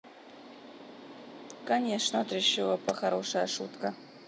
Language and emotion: Russian, neutral